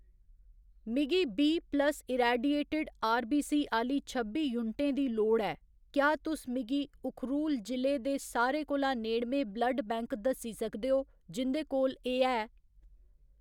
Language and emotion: Dogri, neutral